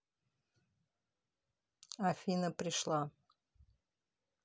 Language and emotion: Russian, neutral